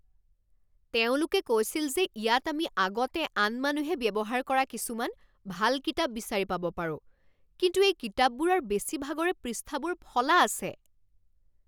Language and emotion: Assamese, angry